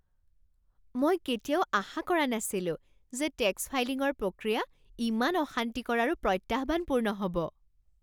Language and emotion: Assamese, surprised